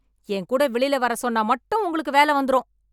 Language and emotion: Tamil, angry